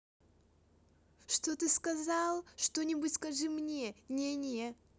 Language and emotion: Russian, angry